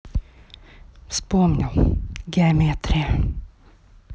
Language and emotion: Russian, neutral